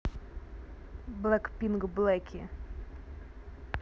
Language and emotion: Russian, neutral